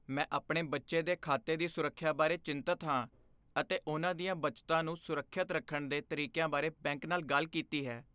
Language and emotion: Punjabi, fearful